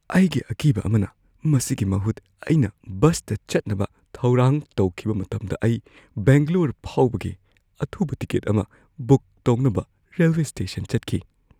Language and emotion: Manipuri, fearful